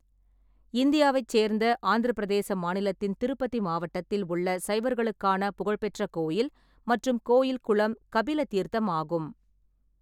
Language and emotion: Tamil, neutral